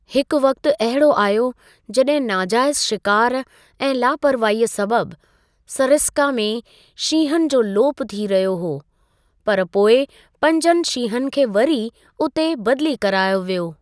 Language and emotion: Sindhi, neutral